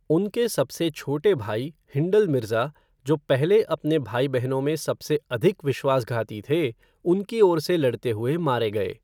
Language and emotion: Hindi, neutral